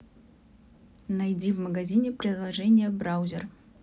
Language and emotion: Russian, neutral